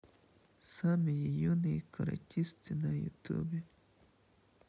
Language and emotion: Russian, sad